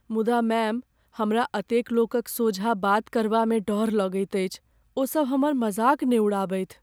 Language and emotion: Maithili, fearful